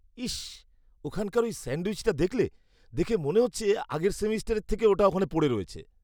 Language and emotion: Bengali, disgusted